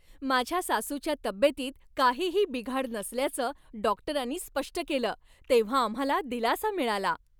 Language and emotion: Marathi, happy